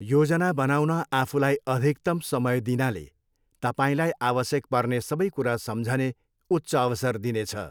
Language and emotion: Nepali, neutral